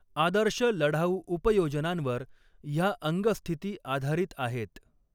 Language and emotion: Marathi, neutral